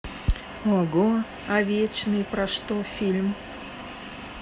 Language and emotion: Russian, sad